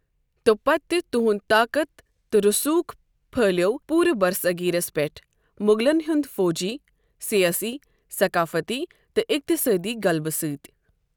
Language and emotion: Kashmiri, neutral